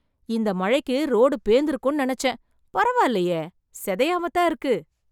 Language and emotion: Tamil, surprised